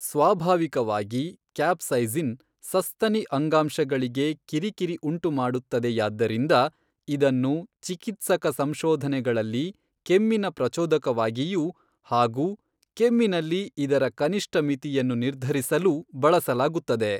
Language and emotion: Kannada, neutral